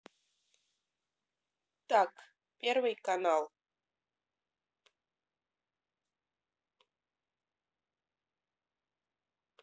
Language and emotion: Russian, neutral